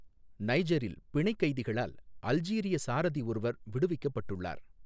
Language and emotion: Tamil, neutral